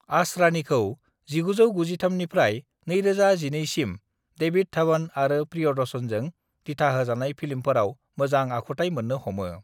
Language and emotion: Bodo, neutral